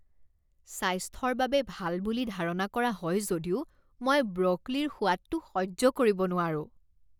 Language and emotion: Assamese, disgusted